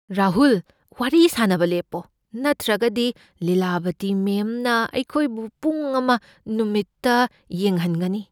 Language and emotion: Manipuri, fearful